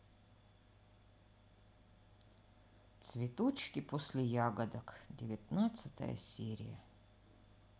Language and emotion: Russian, sad